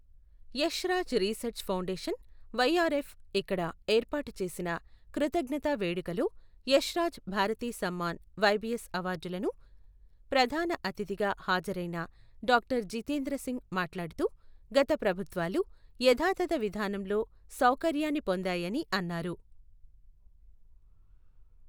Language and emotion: Telugu, neutral